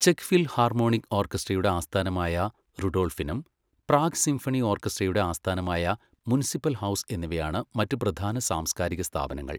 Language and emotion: Malayalam, neutral